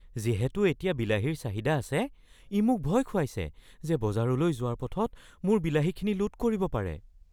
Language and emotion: Assamese, fearful